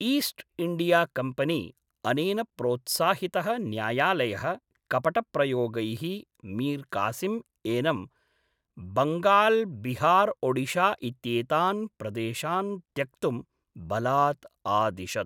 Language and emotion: Sanskrit, neutral